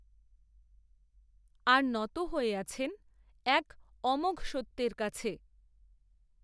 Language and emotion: Bengali, neutral